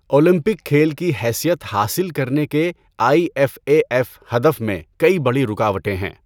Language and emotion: Urdu, neutral